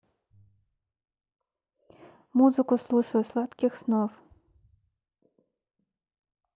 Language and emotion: Russian, neutral